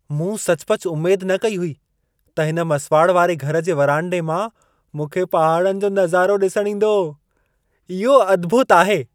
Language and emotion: Sindhi, surprised